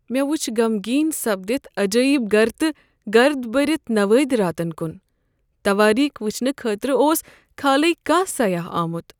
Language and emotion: Kashmiri, sad